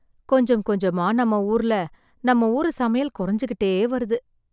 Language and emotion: Tamil, sad